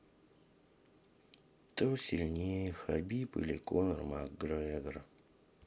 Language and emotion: Russian, sad